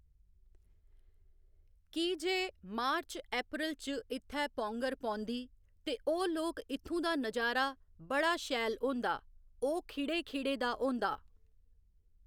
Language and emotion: Dogri, neutral